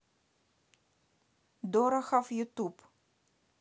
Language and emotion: Russian, neutral